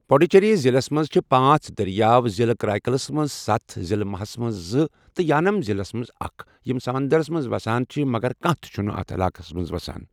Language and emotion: Kashmiri, neutral